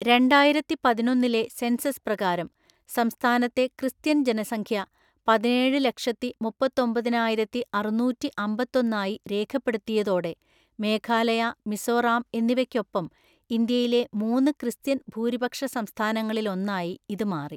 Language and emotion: Malayalam, neutral